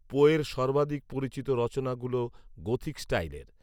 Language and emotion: Bengali, neutral